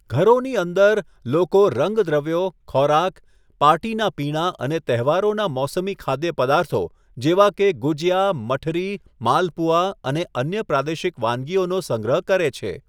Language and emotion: Gujarati, neutral